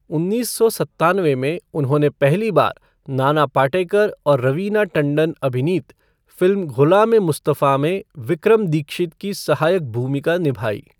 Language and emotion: Hindi, neutral